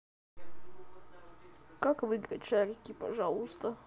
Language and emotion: Russian, sad